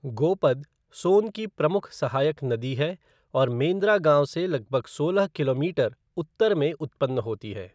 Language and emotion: Hindi, neutral